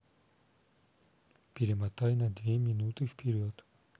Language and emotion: Russian, neutral